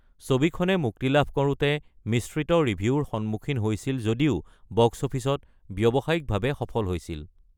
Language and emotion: Assamese, neutral